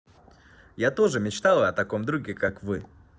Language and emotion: Russian, positive